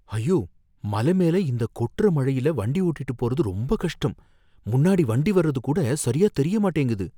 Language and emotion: Tamil, fearful